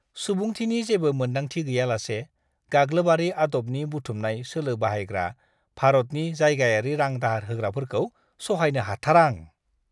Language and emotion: Bodo, disgusted